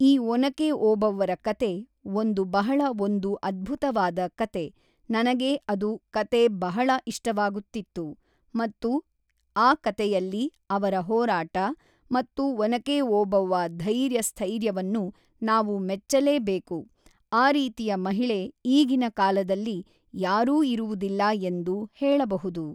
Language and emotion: Kannada, neutral